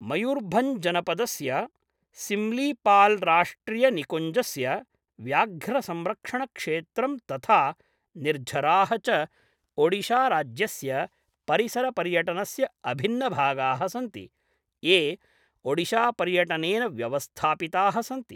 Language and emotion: Sanskrit, neutral